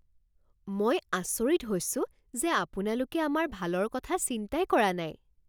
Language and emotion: Assamese, surprised